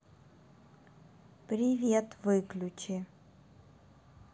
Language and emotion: Russian, neutral